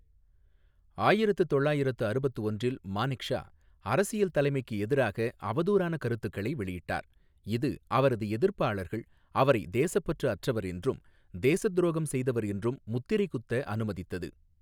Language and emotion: Tamil, neutral